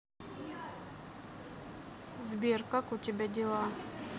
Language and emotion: Russian, neutral